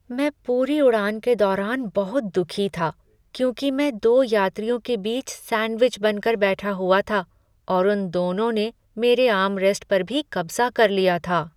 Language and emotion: Hindi, sad